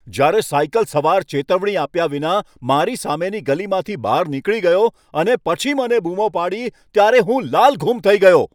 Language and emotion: Gujarati, angry